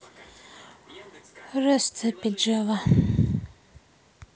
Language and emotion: Russian, sad